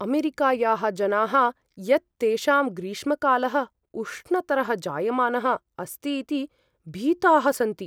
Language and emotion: Sanskrit, fearful